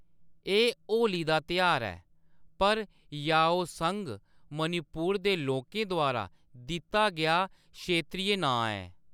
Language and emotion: Dogri, neutral